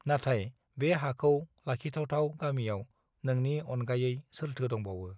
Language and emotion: Bodo, neutral